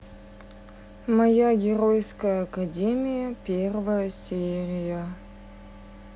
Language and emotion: Russian, sad